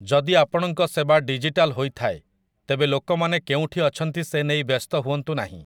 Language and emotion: Odia, neutral